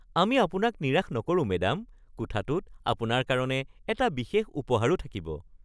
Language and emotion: Assamese, happy